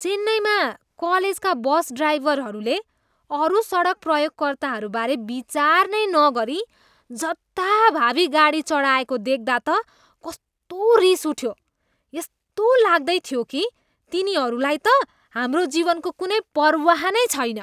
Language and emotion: Nepali, disgusted